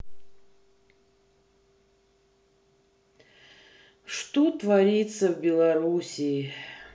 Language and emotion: Russian, sad